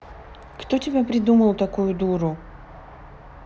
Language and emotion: Russian, neutral